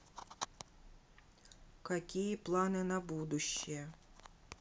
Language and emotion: Russian, neutral